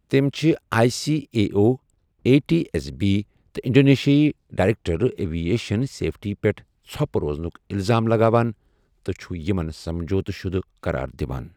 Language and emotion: Kashmiri, neutral